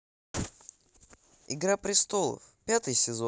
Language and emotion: Russian, positive